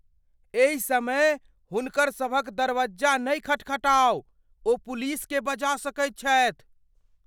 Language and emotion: Maithili, fearful